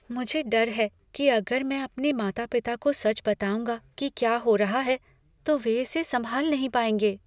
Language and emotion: Hindi, fearful